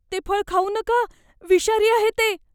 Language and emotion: Marathi, fearful